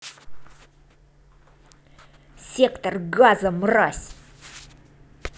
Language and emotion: Russian, angry